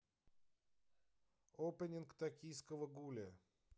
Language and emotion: Russian, neutral